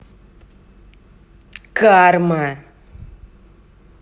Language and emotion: Russian, angry